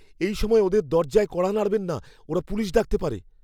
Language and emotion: Bengali, fearful